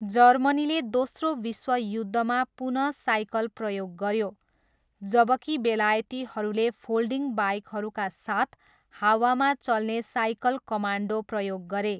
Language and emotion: Nepali, neutral